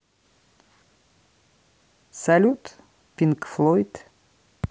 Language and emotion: Russian, neutral